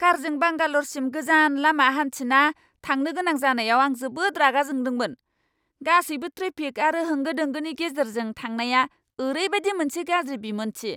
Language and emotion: Bodo, angry